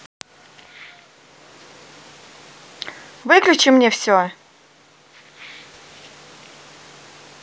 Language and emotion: Russian, angry